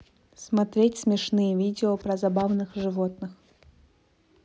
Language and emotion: Russian, neutral